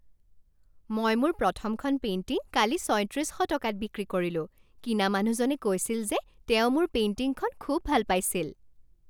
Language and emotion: Assamese, happy